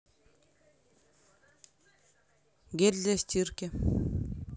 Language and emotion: Russian, neutral